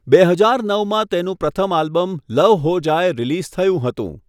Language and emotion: Gujarati, neutral